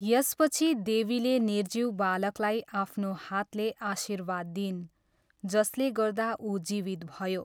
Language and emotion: Nepali, neutral